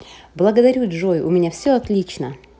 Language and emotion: Russian, positive